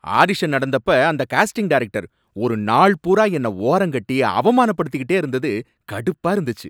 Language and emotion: Tamil, angry